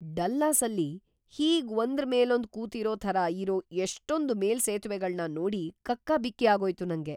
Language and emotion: Kannada, surprised